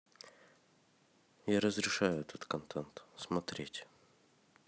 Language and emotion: Russian, neutral